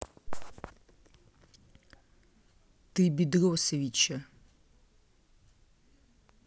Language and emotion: Russian, angry